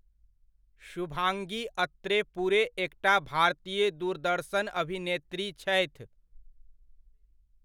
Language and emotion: Maithili, neutral